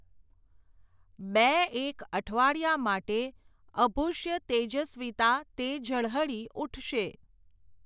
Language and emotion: Gujarati, neutral